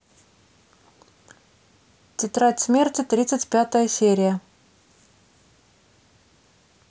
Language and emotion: Russian, neutral